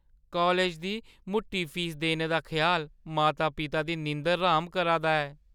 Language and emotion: Dogri, fearful